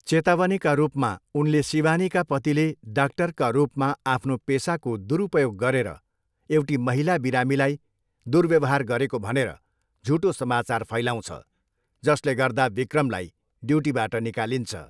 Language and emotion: Nepali, neutral